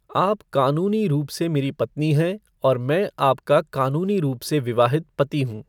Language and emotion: Hindi, neutral